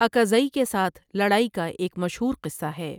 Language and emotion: Urdu, neutral